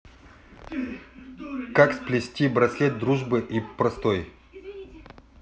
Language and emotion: Russian, neutral